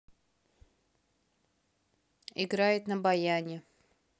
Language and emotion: Russian, neutral